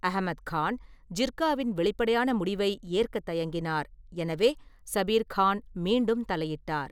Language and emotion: Tamil, neutral